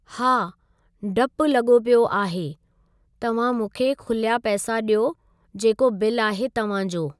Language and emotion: Sindhi, neutral